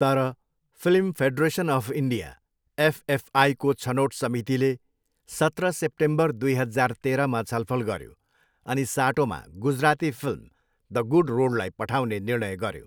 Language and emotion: Nepali, neutral